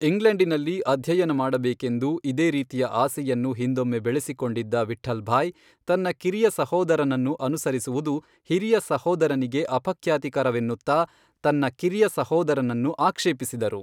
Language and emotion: Kannada, neutral